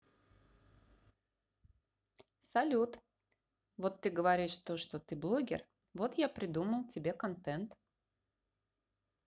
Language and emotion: Russian, neutral